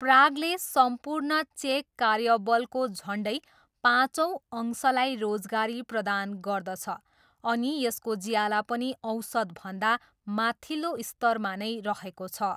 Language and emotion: Nepali, neutral